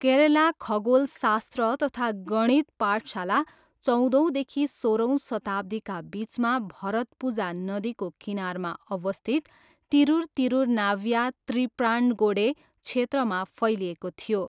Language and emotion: Nepali, neutral